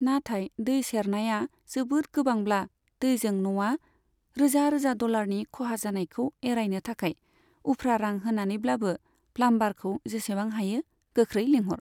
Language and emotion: Bodo, neutral